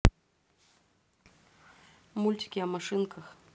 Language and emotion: Russian, neutral